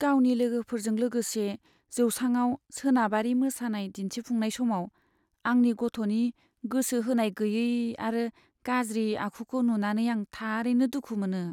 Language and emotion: Bodo, sad